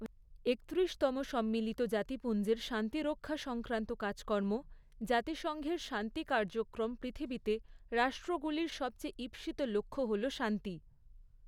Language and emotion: Bengali, neutral